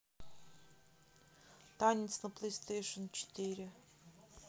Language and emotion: Russian, neutral